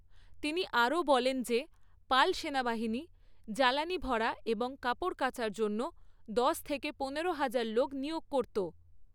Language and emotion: Bengali, neutral